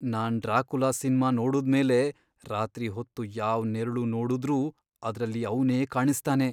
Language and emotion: Kannada, fearful